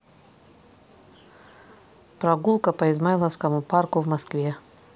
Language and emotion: Russian, neutral